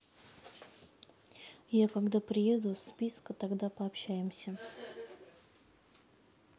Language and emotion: Russian, neutral